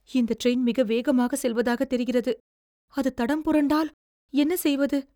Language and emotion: Tamil, fearful